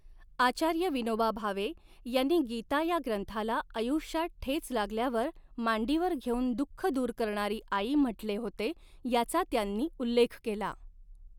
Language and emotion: Marathi, neutral